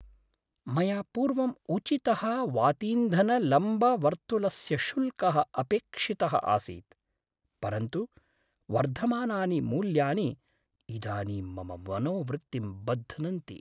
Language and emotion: Sanskrit, sad